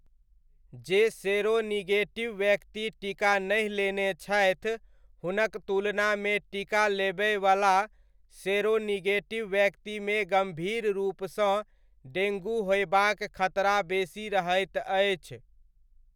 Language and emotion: Maithili, neutral